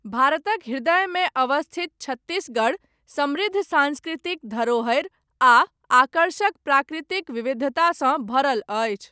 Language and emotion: Maithili, neutral